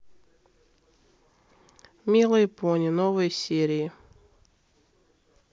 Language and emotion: Russian, neutral